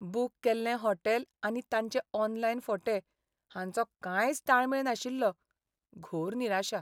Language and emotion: Goan Konkani, sad